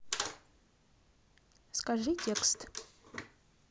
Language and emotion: Russian, neutral